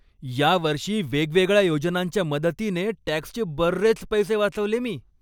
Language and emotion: Marathi, happy